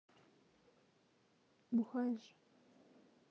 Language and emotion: Russian, neutral